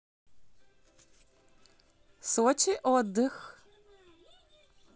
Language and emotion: Russian, positive